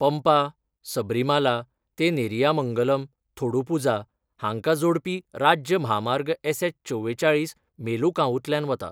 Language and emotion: Goan Konkani, neutral